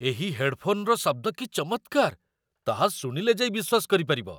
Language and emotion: Odia, surprised